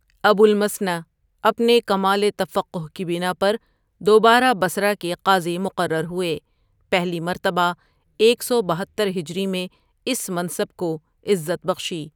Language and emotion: Urdu, neutral